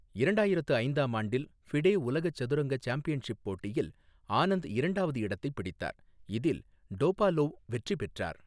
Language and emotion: Tamil, neutral